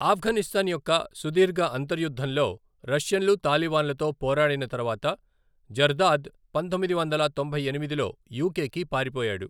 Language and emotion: Telugu, neutral